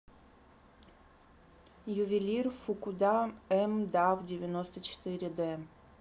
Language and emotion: Russian, neutral